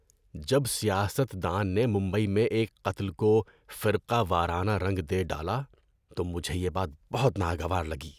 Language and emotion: Urdu, disgusted